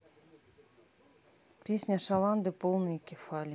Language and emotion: Russian, neutral